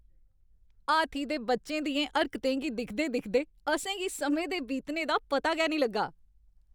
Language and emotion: Dogri, happy